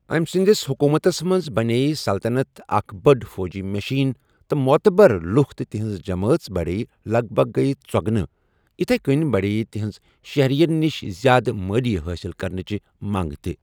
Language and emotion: Kashmiri, neutral